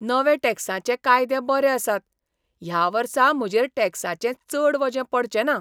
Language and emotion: Goan Konkani, surprised